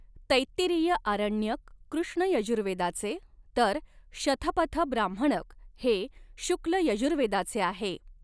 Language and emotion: Marathi, neutral